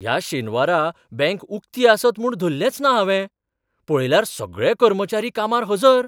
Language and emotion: Goan Konkani, surprised